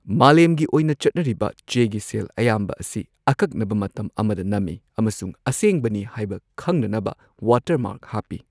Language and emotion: Manipuri, neutral